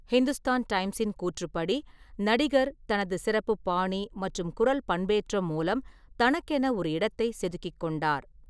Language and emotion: Tamil, neutral